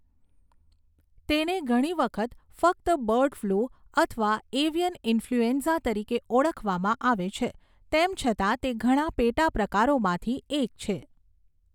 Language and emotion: Gujarati, neutral